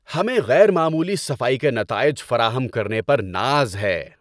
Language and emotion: Urdu, happy